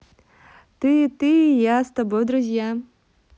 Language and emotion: Russian, positive